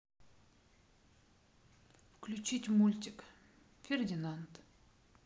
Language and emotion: Russian, neutral